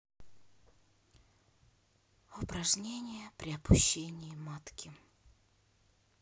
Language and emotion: Russian, sad